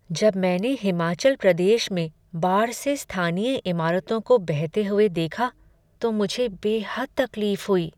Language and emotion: Hindi, sad